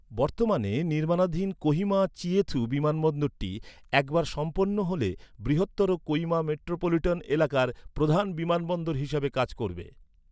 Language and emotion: Bengali, neutral